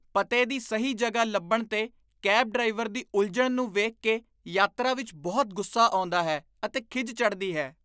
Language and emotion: Punjabi, disgusted